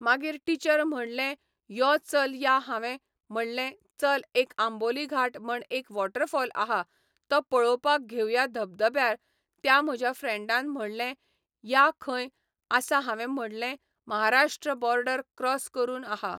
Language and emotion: Goan Konkani, neutral